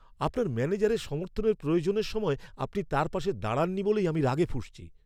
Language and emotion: Bengali, angry